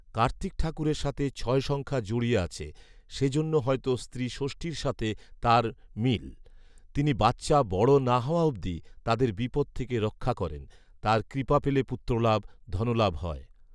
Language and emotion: Bengali, neutral